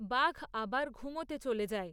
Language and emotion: Bengali, neutral